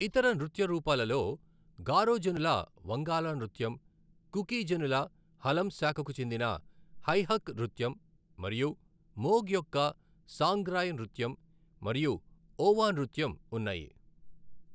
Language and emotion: Telugu, neutral